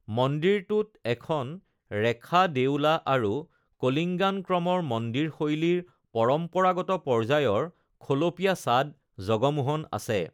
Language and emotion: Assamese, neutral